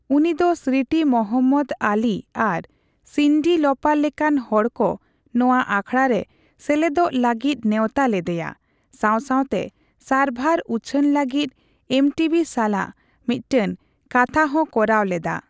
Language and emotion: Santali, neutral